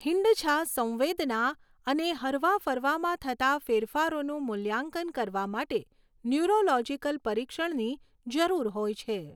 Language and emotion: Gujarati, neutral